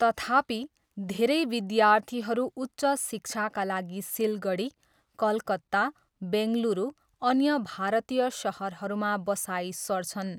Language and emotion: Nepali, neutral